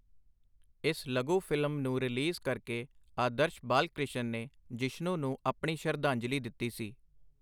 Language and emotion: Punjabi, neutral